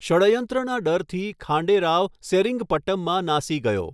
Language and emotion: Gujarati, neutral